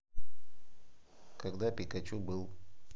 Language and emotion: Russian, neutral